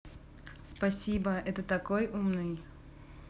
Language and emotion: Russian, positive